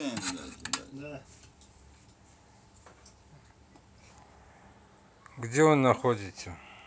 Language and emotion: Russian, neutral